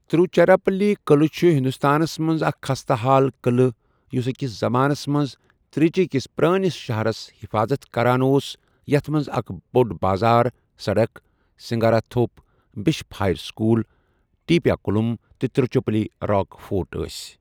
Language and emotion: Kashmiri, neutral